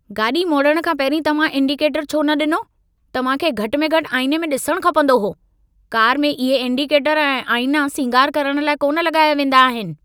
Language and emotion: Sindhi, angry